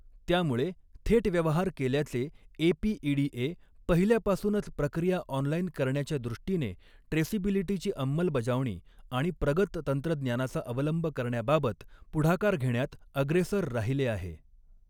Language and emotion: Marathi, neutral